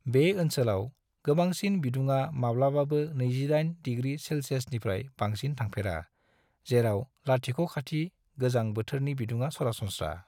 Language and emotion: Bodo, neutral